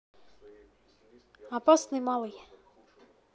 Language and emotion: Russian, neutral